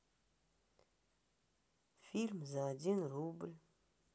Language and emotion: Russian, sad